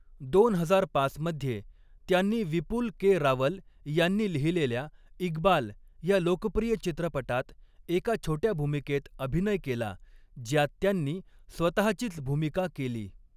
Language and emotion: Marathi, neutral